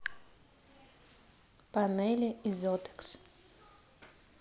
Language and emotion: Russian, neutral